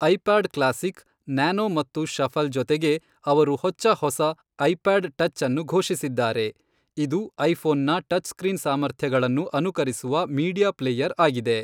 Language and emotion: Kannada, neutral